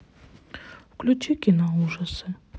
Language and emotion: Russian, sad